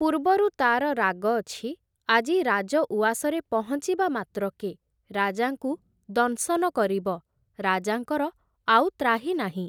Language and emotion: Odia, neutral